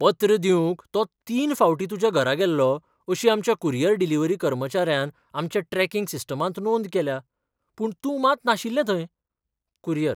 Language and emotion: Goan Konkani, surprised